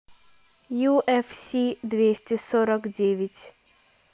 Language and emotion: Russian, neutral